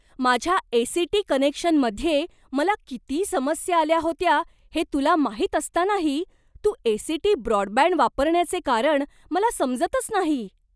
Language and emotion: Marathi, surprised